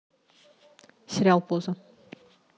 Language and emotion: Russian, neutral